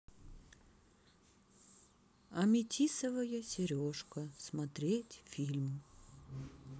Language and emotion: Russian, sad